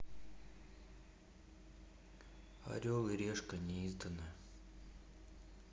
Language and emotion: Russian, sad